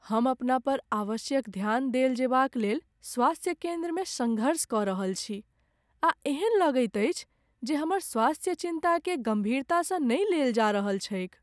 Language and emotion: Maithili, sad